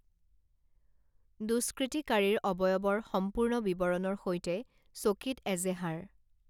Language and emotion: Assamese, neutral